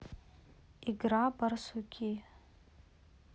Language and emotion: Russian, neutral